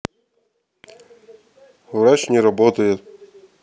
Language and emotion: Russian, neutral